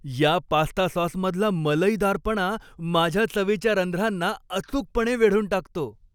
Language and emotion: Marathi, happy